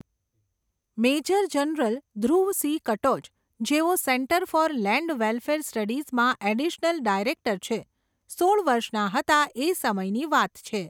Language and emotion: Gujarati, neutral